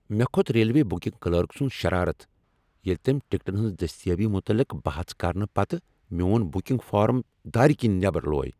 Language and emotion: Kashmiri, angry